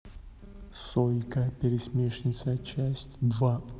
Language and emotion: Russian, neutral